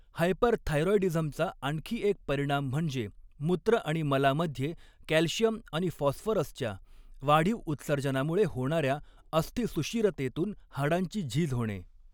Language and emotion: Marathi, neutral